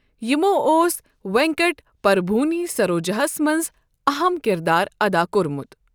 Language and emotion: Kashmiri, neutral